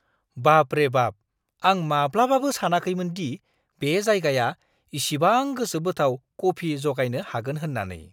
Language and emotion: Bodo, surprised